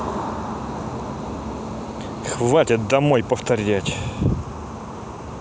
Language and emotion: Russian, angry